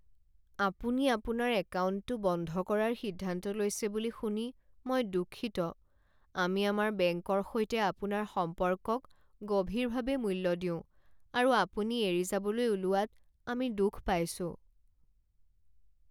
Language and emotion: Assamese, sad